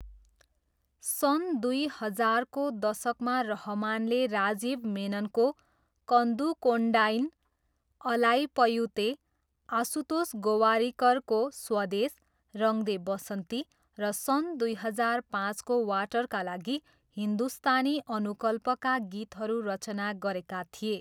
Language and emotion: Nepali, neutral